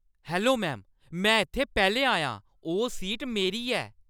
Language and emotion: Dogri, angry